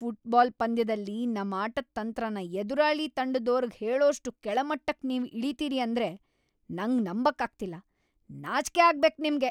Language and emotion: Kannada, angry